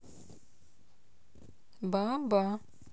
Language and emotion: Russian, neutral